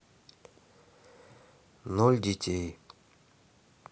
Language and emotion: Russian, neutral